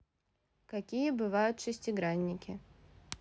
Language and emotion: Russian, neutral